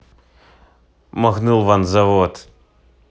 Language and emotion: Russian, neutral